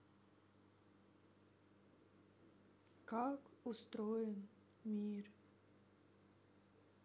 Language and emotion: Russian, sad